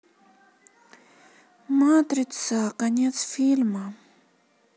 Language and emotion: Russian, sad